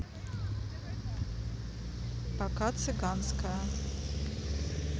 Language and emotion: Russian, neutral